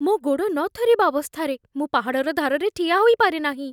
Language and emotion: Odia, fearful